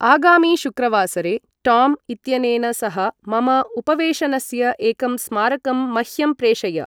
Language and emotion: Sanskrit, neutral